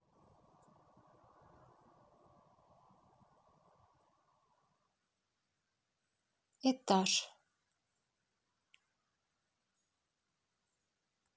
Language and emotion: Russian, neutral